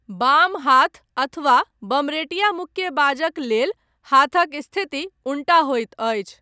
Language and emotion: Maithili, neutral